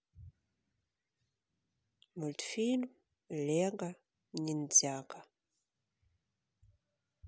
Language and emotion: Russian, neutral